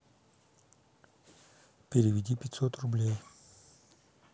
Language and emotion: Russian, neutral